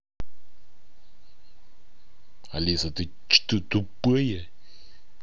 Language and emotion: Russian, angry